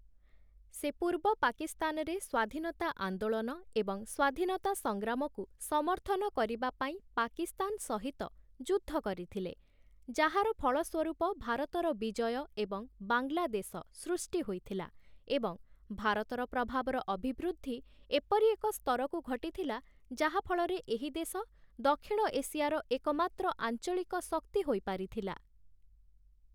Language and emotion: Odia, neutral